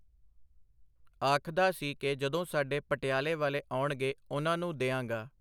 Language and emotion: Punjabi, neutral